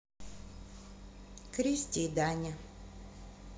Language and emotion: Russian, neutral